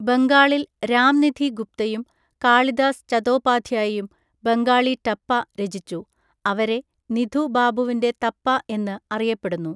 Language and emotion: Malayalam, neutral